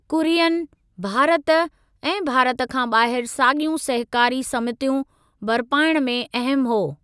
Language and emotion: Sindhi, neutral